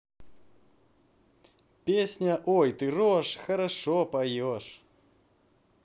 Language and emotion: Russian, positive